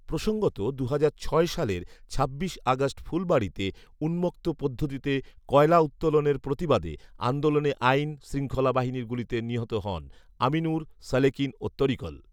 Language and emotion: Bengali, neutral